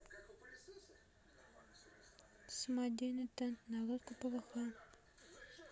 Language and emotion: Russian, neutral